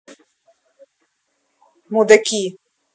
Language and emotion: Russian, angry